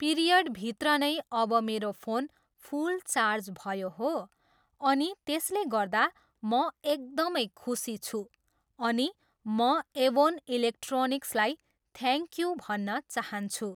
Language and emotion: Nepali, neutral